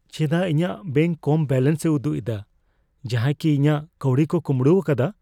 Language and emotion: Santali, fearful